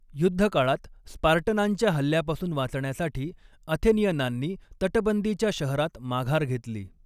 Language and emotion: Marathi, neutral